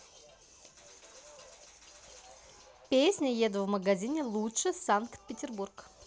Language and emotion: Russian, positive